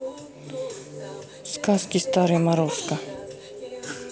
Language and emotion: Russian, neutral